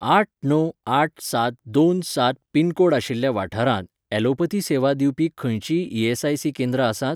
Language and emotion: Goan Konkani, neutral